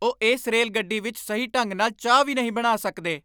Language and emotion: Punjabi, angry